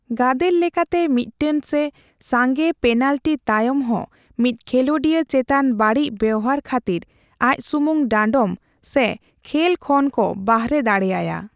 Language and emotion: Santali, neutral